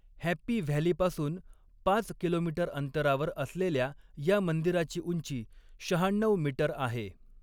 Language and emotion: Marathi, neutral